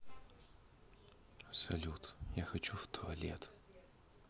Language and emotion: Russian, neutral